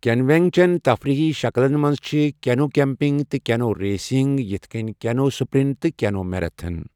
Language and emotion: Kashmiri, neutral